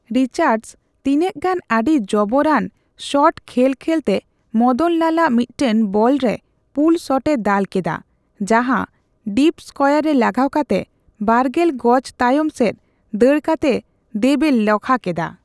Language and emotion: Santali, neutral